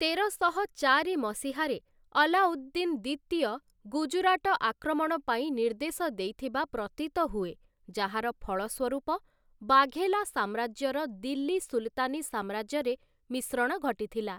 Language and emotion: Odia, neutral